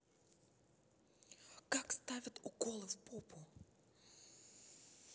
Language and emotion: Russian, neutral